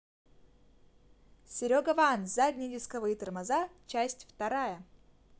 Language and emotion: Russian, positive